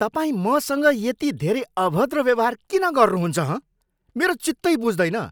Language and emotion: Nepali, angry